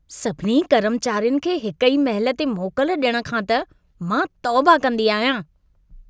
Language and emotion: Sindhi, disgusted